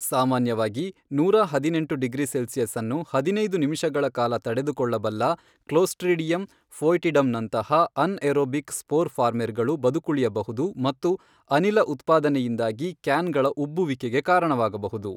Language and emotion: Kannada, neutral